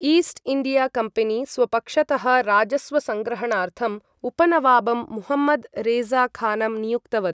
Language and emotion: Sanskrit, neutral